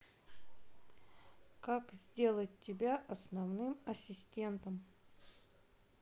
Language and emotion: Russian, neutral